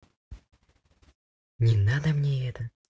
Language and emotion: Russian, neutral